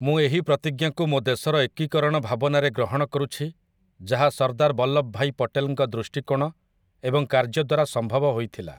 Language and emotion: Odia, neutral